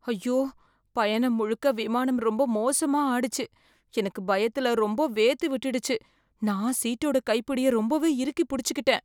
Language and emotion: Tamil, fearful